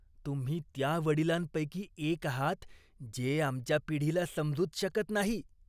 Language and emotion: Marathi, disgusted